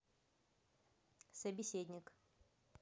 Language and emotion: Russian, neutral